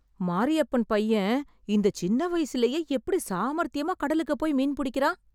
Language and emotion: Tamil, surprised